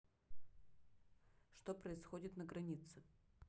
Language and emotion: Russian, neutral